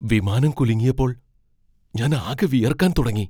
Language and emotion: Malayalam, fearful